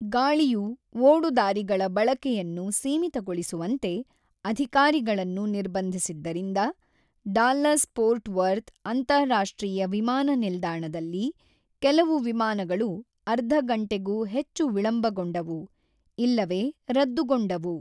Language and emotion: Kannada, neutral